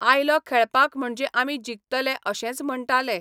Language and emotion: Goan Konkani, neutral